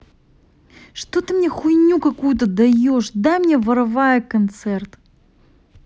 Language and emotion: Russian, angry